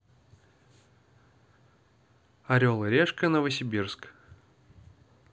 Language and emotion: Russian, neutral